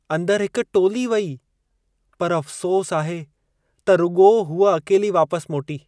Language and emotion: Sindhi, sad